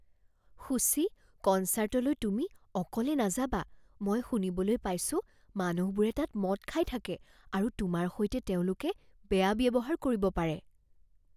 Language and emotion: Assamese, fearful